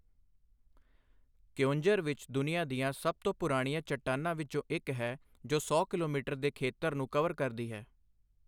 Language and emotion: Punjabi, neutral